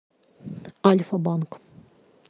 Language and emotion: Russian, neutral